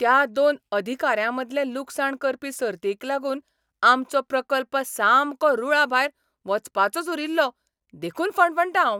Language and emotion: Goan Konkani, angry